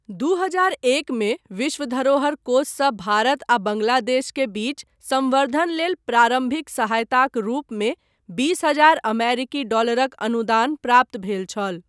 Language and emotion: Maithili, neutral